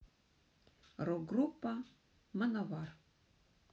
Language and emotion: Russian, neutral